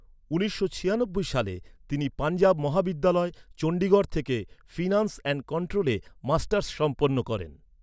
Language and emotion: Bengali, neutral